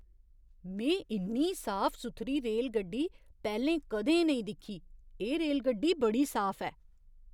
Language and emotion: Dogri, surprised